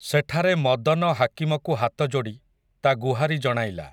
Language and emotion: Odia, neutral